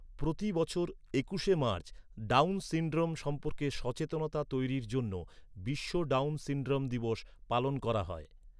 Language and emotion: Bengali, neutral